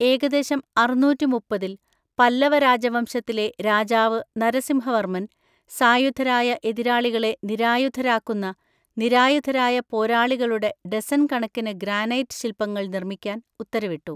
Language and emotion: Malayalam, neutral